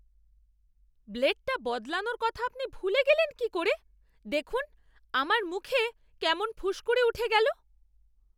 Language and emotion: Bengali, angry